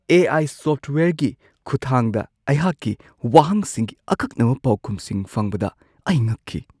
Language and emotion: Manipuri, surprised